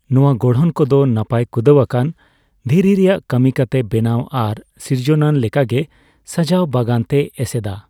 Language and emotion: Santali, neutral